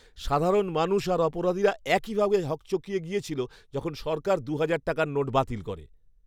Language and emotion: Bengali, surprised